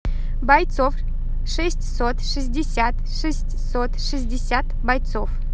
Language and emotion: Russian, positive